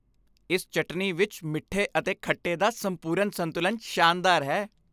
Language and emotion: Punjabi, happy